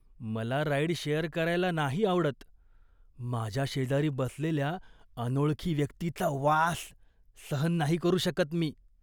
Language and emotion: Marathi, disgusted